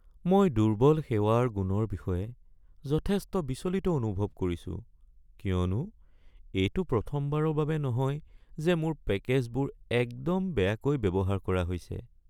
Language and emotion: Assamese, sad